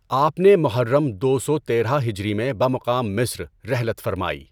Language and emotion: Urdu, neutral